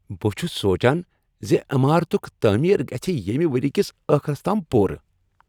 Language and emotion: Kashmiri, happy